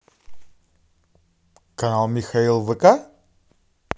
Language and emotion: Russian, positive